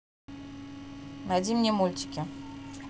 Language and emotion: Russian, neutral